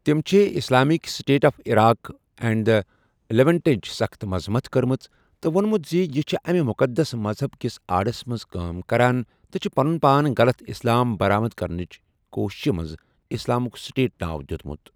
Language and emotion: Kashmiri, neutral